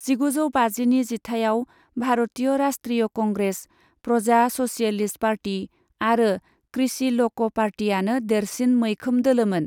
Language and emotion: Bodo, neutral